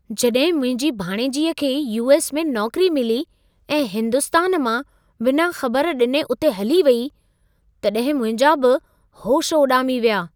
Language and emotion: Sindhi, surprised